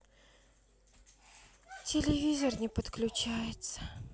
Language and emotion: Russian, sad